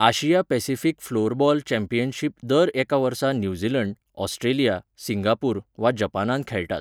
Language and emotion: Goan Konkani, neutral